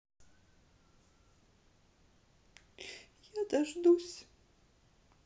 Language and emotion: Russian, sad